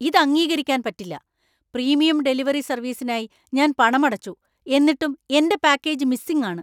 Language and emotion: Malayalam, angry